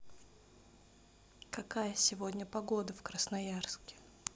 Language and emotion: Russian, neutral